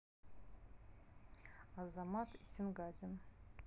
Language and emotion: Russian, neutral